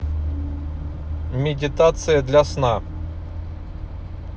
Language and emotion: Russian, neutral